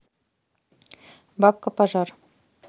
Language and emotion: Russian, neutral